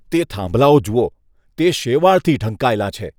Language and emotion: Gujarati, disgusted